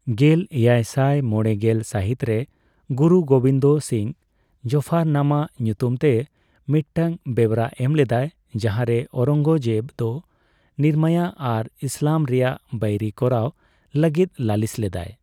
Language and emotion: Santali, neutral